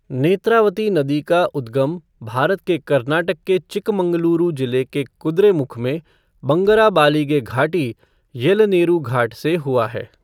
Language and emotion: Hindi, neutral